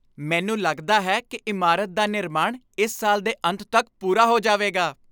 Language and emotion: Punjabi, happy